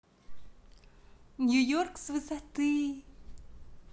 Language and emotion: Russian, positive